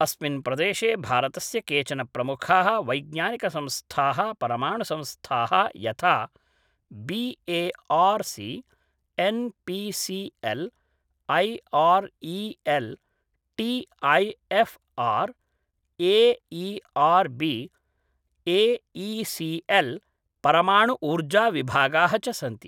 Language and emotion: Sanskrit, neutral